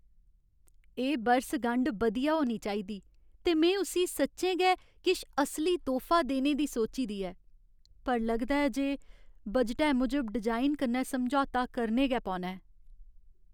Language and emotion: Dogri, sad